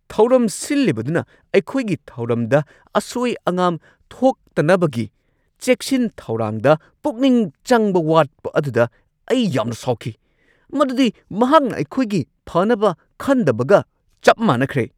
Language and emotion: Manipuri, angry